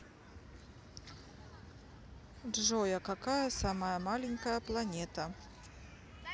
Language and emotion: Russian, neutral